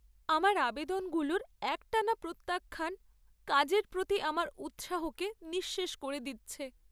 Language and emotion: Bengali, sad